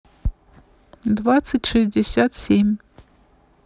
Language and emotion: Russian, neutral